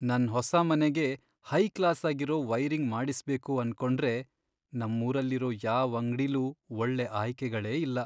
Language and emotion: Kannada, sad